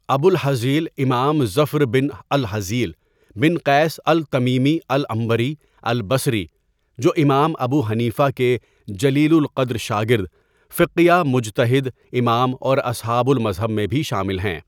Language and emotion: Urdu, neutral